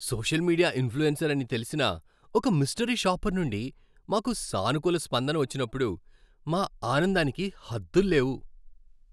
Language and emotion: Telugu, happy